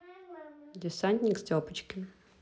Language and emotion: Russian, neutral